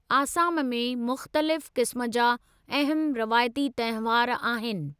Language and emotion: Sindhi, neutral